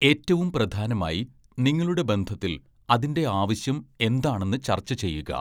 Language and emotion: Malayalam, neutral